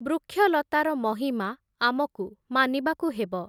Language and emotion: Odia, neutral